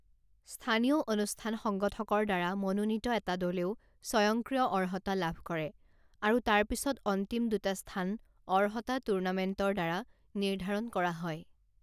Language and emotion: Assamese, neutral